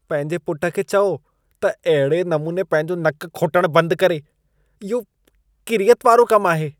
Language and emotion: Sindhi, disgusted